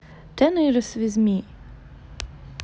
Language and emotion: Russian, neutral